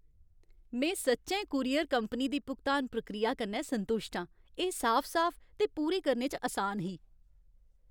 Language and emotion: Dogri, happy